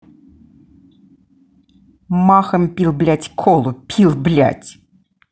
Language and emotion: Russian, angry